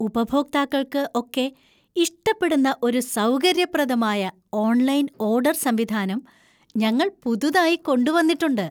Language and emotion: Malayalam, happy